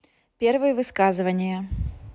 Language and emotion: Russian, neutral